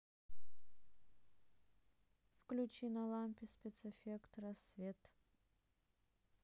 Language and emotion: Russian, neutral